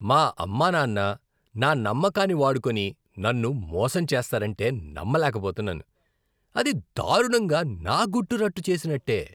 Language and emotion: Telugu, disgusted